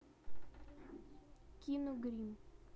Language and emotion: Russian, neutral